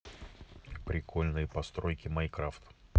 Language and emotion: Russian, neutral